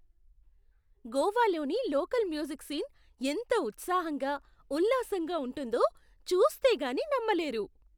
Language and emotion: Telugu, surprised